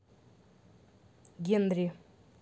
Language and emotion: Russian, neutral